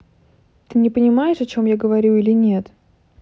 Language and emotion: Russian, angry